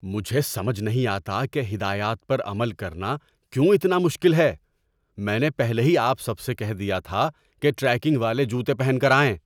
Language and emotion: Urdu, angry